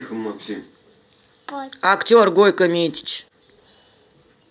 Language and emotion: Russian, angry